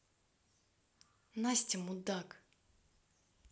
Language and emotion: Russian, angry